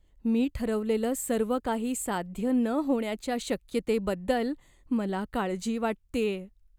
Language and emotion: Marathi, fearful